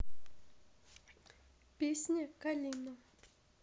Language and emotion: Russian, neutral